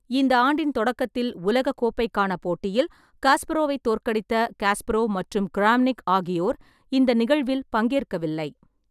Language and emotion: Tamil, neutral